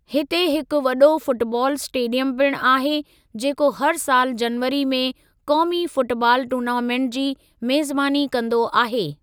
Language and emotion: Sindhi, neutral